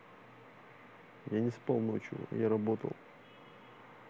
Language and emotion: Russian, neutral